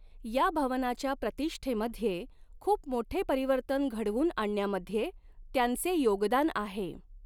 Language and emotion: Marathi, neutral